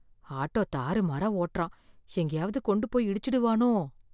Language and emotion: Tamil, fearful